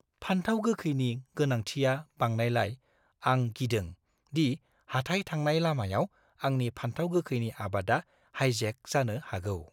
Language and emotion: Bodo, fearful